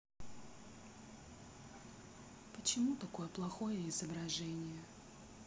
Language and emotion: Russian, sad